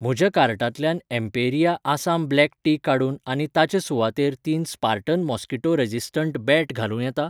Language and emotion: Goan Konkani, neutral